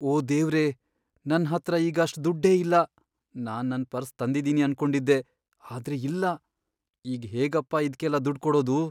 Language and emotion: Kannada, fearful